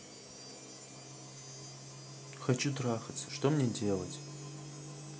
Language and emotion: Russian, sad